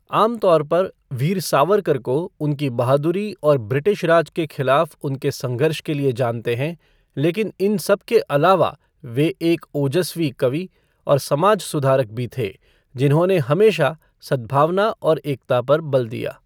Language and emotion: Hindi, neutral